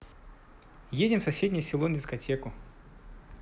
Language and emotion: Russian, neutral